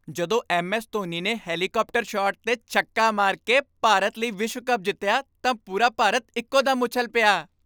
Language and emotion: Punjabi, happy